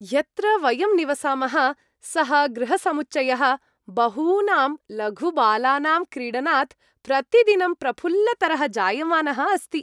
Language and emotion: Sanskrit, happy